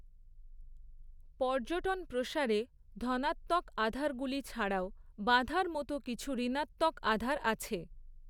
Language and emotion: Bengali, neutral